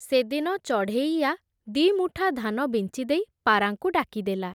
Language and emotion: Odia, neutral